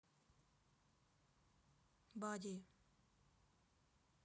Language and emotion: Russian, neutral